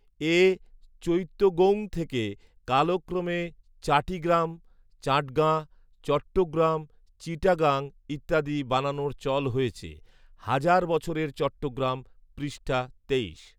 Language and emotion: Bengali, neutral